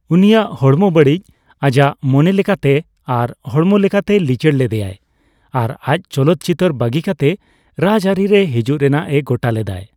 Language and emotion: Santali, neutral